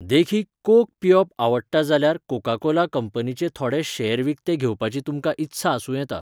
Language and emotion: Goan Konkani, neutral